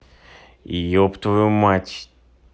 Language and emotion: Russian, angry